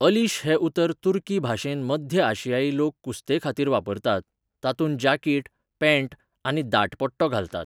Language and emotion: Goan Konkani, neutral